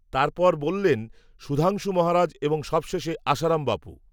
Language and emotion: Bengali, neutral